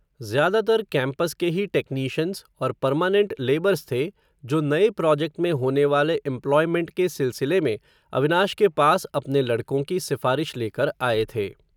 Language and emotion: Hindi, neutral